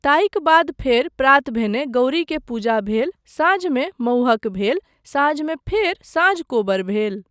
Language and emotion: Maithili, neutral